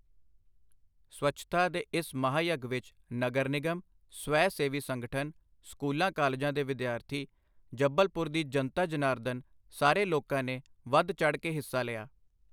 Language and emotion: Punjabi, neutral